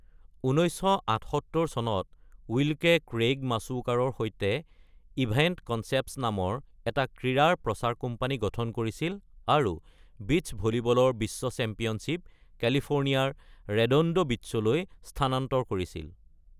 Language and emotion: Assamese, neutral